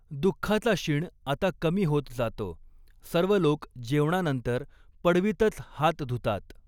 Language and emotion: Marathi, neutral